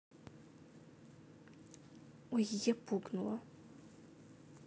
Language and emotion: Russian, sad